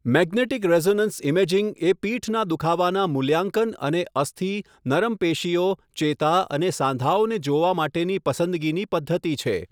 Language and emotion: Gujarati, neutral